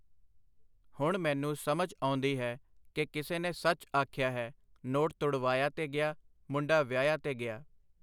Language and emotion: Punjabi, neutral